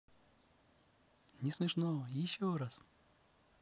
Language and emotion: Russian, positive